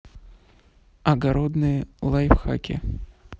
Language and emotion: Russian, neutral